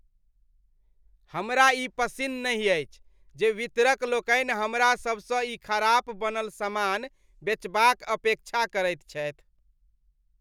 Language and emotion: Maithili, disgusted